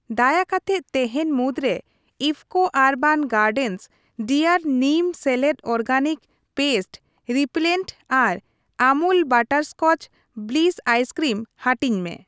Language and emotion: Santali, neutral